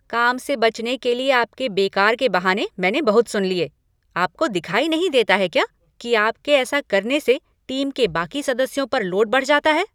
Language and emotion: Hindi, angry